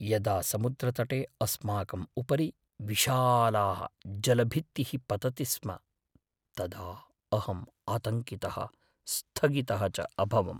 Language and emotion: Sanskrit, fearful